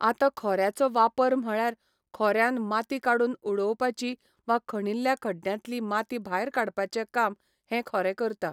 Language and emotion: Goan Konkani, neutral